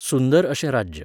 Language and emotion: Goan Konkani, neutral